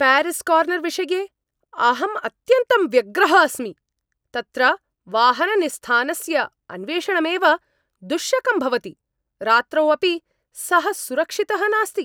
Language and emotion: Sanskrit, angry